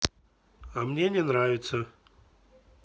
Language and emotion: Russian, neutral